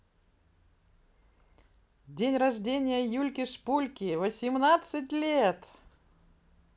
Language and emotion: Russian, positive